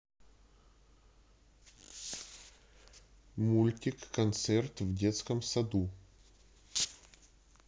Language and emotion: Russian, neutral